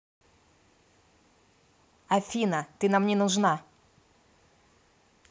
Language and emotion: Russian, angry